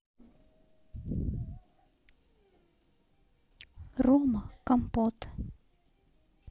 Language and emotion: Russian, neutral